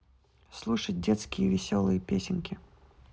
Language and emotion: Russian, neutral